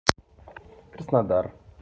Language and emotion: Russian, neutral